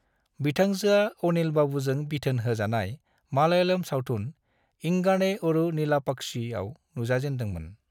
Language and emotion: Bodo, neutral